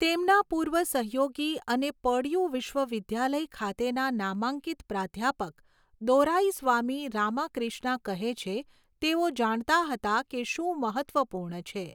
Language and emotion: Gujarati, neutral